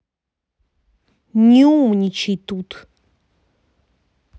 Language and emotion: Russian, angry